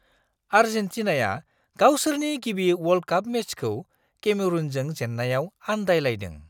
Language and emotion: Bodo, surprised